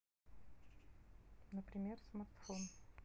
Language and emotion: Russian, neutral